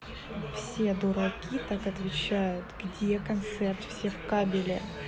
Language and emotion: Russian, neutral